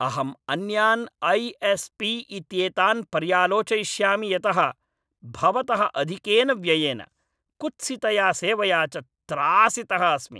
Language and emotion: Sanskrit, angry